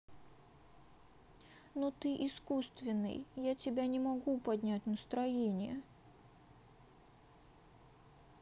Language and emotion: Russian, sad